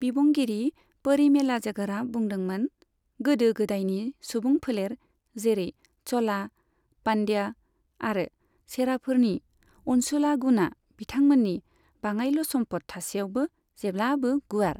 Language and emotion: Bodo, neutral